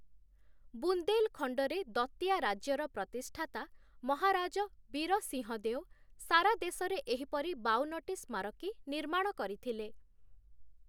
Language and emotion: Odia, neutral